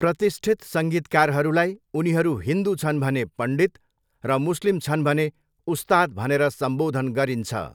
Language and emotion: Nepali, neutral